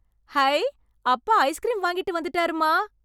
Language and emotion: Tamil, happy